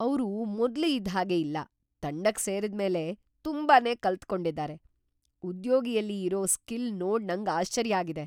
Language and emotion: Kannada, surprised